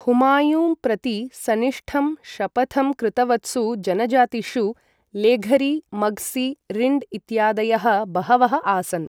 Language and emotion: Sanskrit, neutral